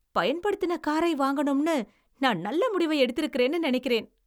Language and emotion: Tamil, happy